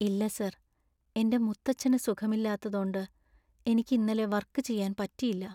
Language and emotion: Malayalam, sad